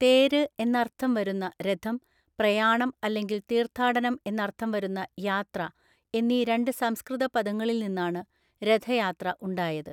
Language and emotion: Malayalam, neutral